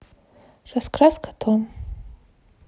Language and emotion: Russian, neutral